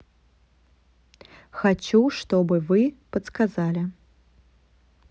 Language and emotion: Russian, neutral